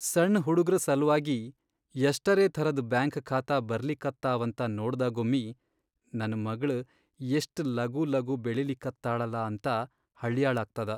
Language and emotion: Kannada, sad